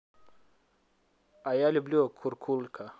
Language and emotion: Russian, neutral